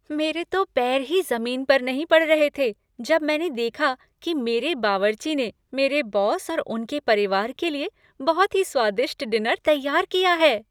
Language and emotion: Hindi, happy